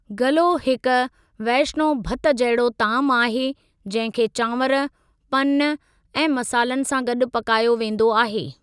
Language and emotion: Sindhi, neutral